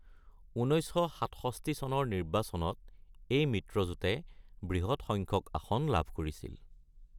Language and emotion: Assamese, neutral